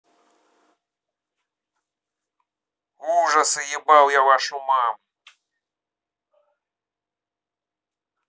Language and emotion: Russian, angry